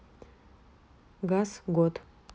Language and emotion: Russian, neutral